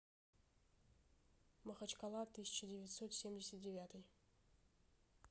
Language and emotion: Russian, neutral